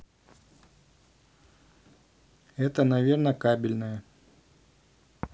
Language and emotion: Russian, neutral